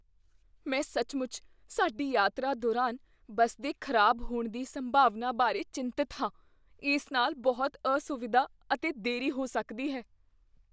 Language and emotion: Punjabi, fearful